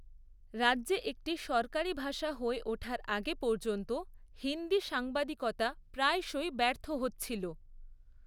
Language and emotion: Bengali, neutral